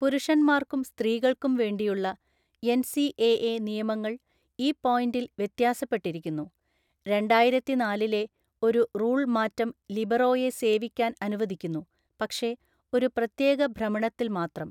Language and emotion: Malayalam, neutral